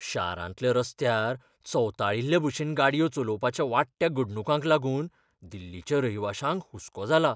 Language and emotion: Goan Konkani, fearful